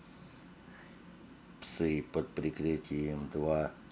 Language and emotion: Russian, neutral